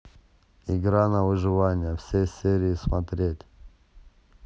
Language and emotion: Russian, neutral